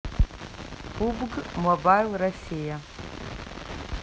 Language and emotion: Russian, neutral